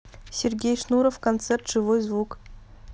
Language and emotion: Russian, neutral